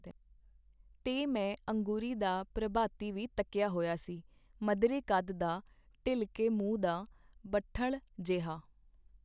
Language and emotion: Punjabi, neutral